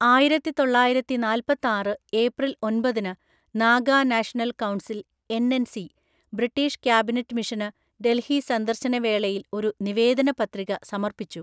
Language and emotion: Malayalam, neutral